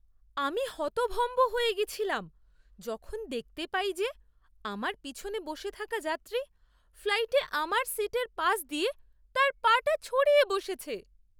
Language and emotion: Bengali, surprised